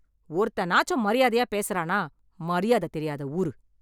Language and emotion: Tamil, angry